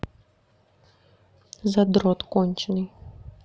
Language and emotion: Russian, neutral